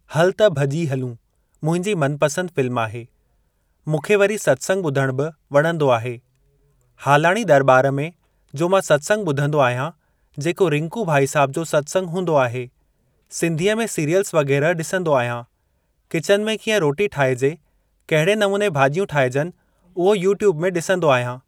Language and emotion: Sindhi, neutral